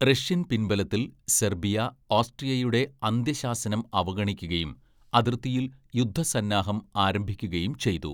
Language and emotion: Malayalam, neutral